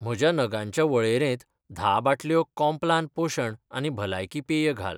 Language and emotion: Goan Konkani, neutral